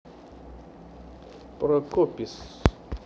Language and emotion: Russian, neutral